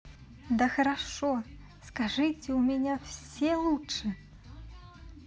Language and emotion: Russian, positive